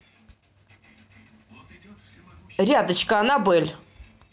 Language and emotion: Russian, neutral